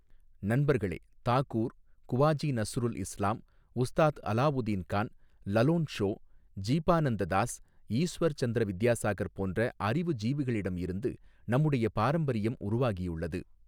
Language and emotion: Tamil, neutral